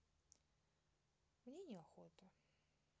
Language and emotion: Russian, sad